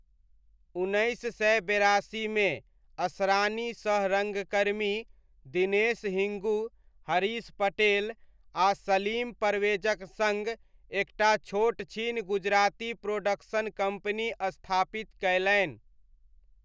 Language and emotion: Maithili, neutral